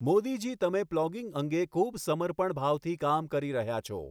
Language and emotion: Gujarati, neutral